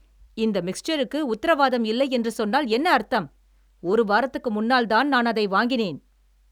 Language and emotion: Tamil, angry